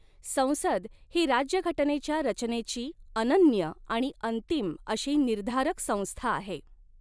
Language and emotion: Marathi, neutral